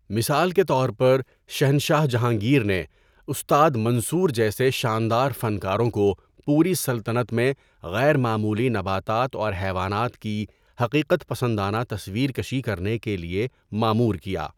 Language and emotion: Urdu, neutral